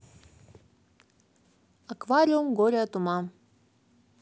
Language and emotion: Russian, neutral